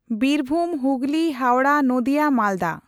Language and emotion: Santali, neutral